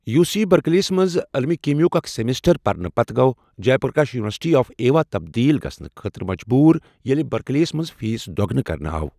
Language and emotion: Kashmiri, neutral